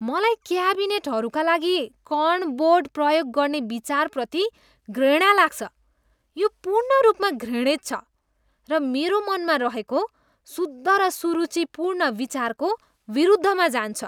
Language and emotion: Nepali, disgusted